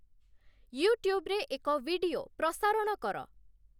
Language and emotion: Odia, neutral